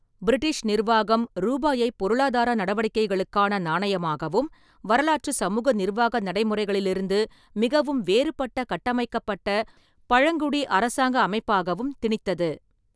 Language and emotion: Tamil, neutral